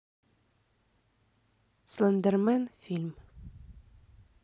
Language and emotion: Russian, neutral